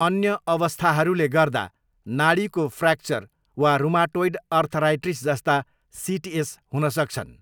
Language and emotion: Nepali, neutral